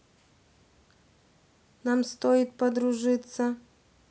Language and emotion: Russian, neutral